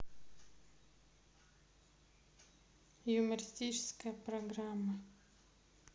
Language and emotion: Russian, neutral